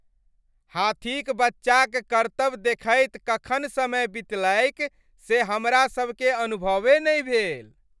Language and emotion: Maithili, happy